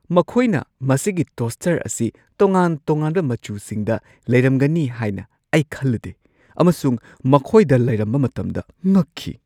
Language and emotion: Manipuri, surprised